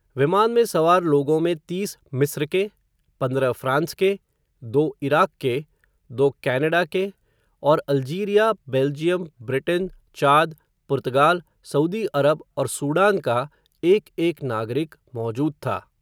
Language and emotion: Hindi, neutral